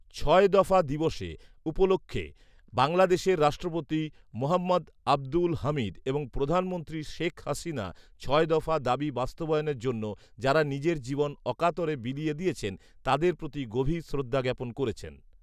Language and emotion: Bengali, neutral